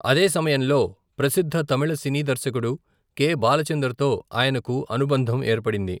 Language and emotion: Telugu, neutral